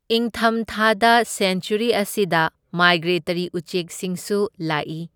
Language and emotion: Manipuri, neutral